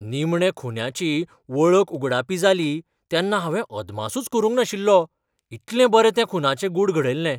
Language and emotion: Goan Konkani, surprised